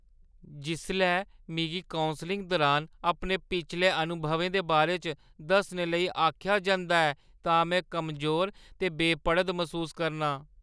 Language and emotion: Dogri, fearful